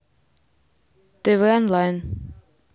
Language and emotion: Russian, neutral